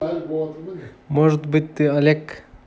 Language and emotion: Russian, neutral